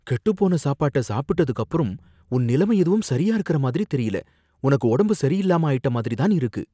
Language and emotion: Tamil, fearful